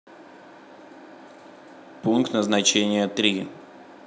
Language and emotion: Russian, neutral